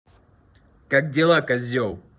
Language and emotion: Russian, angry